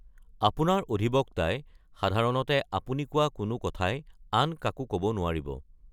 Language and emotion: Assamese, neutral